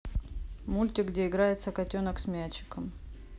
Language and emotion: Russian, neutral